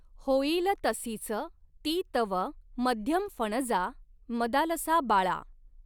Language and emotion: Marathi, neutral